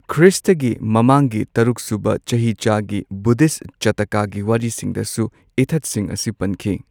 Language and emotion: Manipuri, neutral